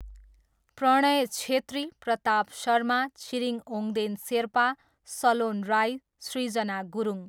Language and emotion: Nepali, neutral